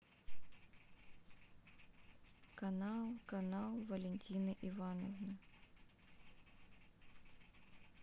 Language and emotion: Russian, neutral